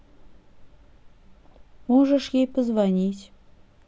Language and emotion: Russian, sad